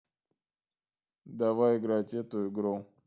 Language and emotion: Russian, neutral